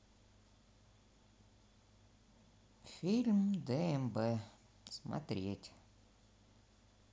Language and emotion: Russian, neutral